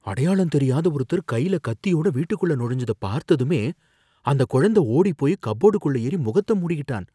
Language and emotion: Tamil, fearful